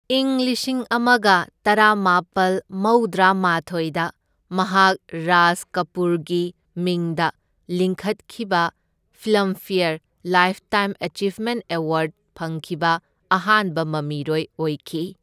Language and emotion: Manipuri, neutral